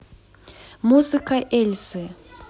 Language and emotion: Russian, neutral